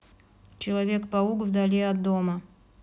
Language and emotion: Russian, neutral